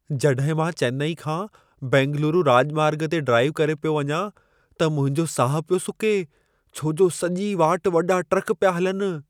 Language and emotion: Sindhi, fearful